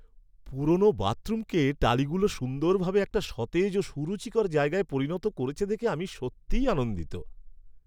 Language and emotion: Bengali, happy